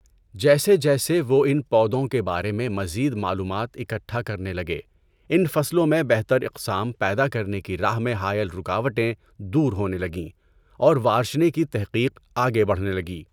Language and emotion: Urdu, neutral